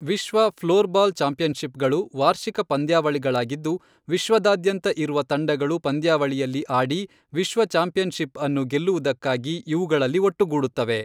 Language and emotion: Kannada, neutral